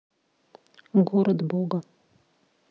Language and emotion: Russian, neutral